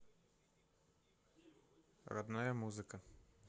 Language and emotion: Russian, neutral